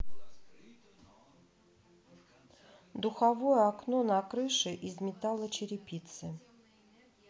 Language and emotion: Russian, neutral